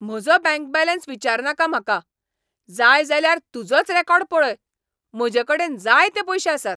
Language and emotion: Goan Konkani, angry